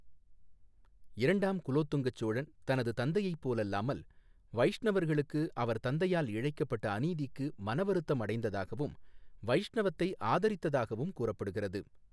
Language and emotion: Tamil, neutral